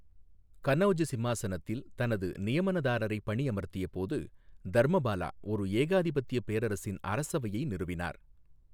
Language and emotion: Tamil, neutral